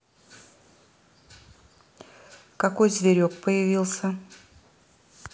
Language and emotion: Russian, neutral